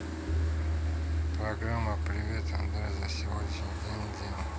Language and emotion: Russian, neutral